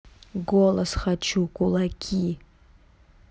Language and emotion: Russian, neutral